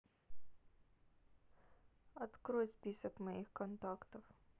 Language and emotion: Russian, sad